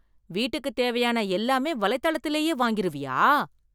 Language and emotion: Tamil, surprised